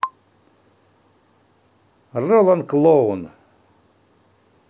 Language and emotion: Russian, positive